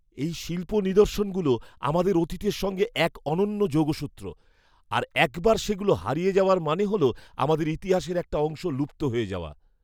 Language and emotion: Bengali, fearful